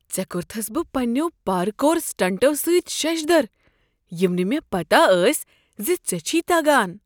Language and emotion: Kashmiri, surprised